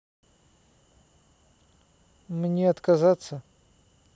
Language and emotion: Russian, neutral